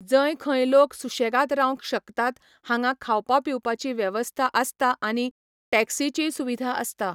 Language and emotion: Goan Konkani, neutral